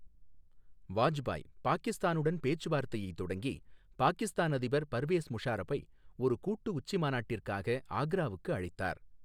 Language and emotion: Tamil, neutral